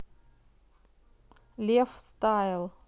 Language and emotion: Russian, neutral